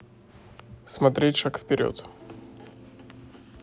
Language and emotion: Russian, neutral